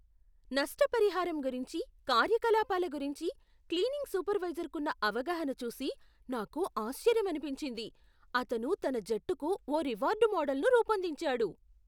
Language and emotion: Telugu, surprised